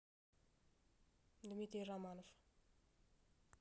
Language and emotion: Russian, neutral